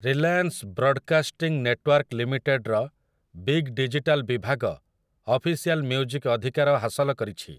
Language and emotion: Odia, neutral